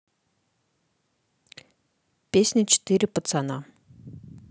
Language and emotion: Russian, neutral